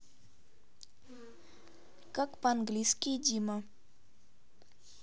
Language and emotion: Russian, neutral